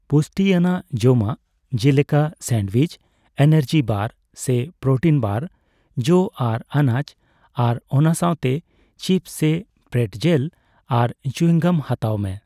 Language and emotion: Santali, neutral